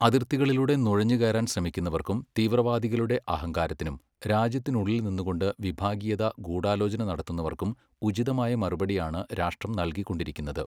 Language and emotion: Malayalam, neutral